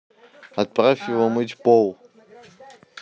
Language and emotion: Russian, neutral